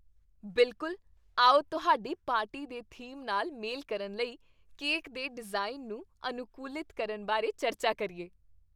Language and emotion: Punjabi, happy